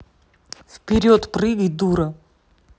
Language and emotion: Russian, angry